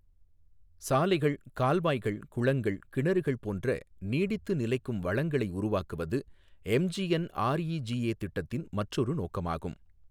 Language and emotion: Tamil, neutral